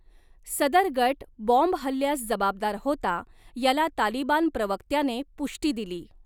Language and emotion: Marathi, neutral